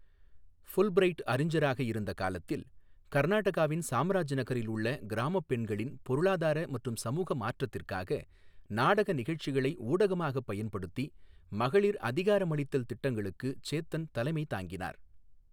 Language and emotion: Tamil, neutral